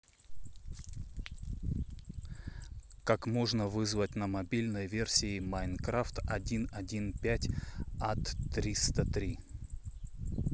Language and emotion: Russian, neutral